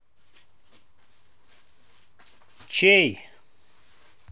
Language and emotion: Russian, neutral